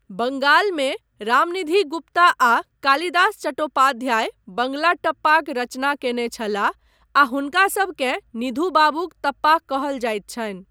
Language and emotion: Maithili, neutral